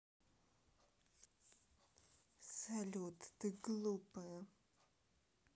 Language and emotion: Russian, neutral